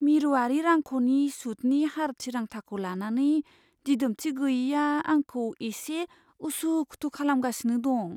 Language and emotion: Bodo, fearful